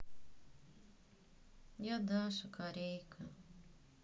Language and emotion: Russian, sad